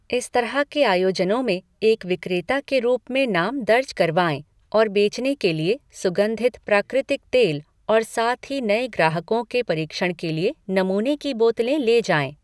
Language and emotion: Hindi, neutral